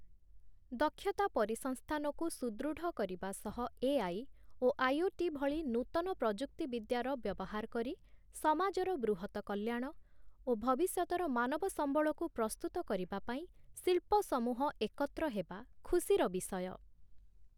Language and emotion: Odia, neutral